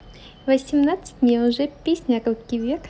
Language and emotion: Russian, positive